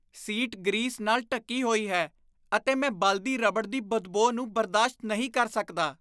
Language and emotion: Punjabi, disgusted